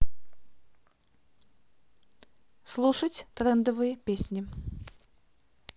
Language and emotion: Russian, neutral